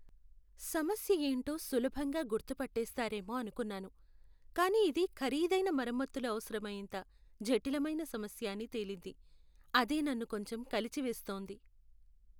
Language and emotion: Telugu, sad